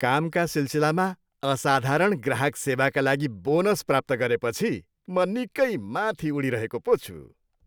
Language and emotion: Nepali, happy